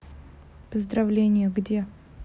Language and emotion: Russian, neutral